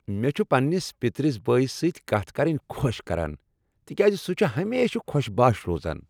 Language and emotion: Kashmiri, happy